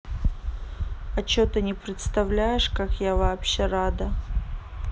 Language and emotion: Russian, neutral